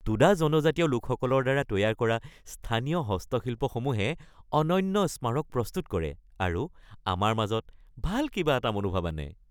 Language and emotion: Assamese, happy